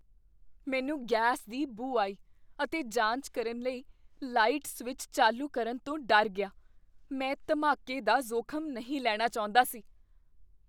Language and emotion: Punjabi, fearful